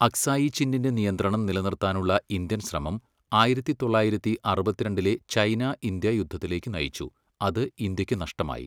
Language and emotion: Malayalam, neutral